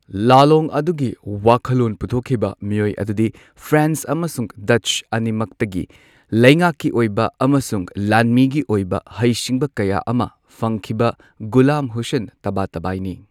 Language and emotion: Manipuri, neutral